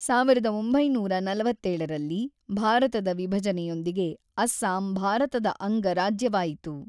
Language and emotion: Kannada, neutral